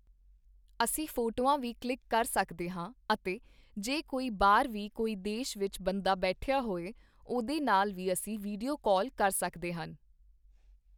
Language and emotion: Punjabi, neutral